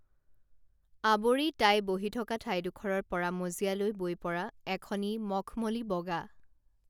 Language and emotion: Assamese, neutral